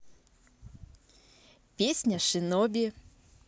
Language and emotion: Russian, neutral